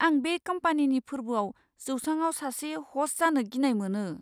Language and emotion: Bodo, fearful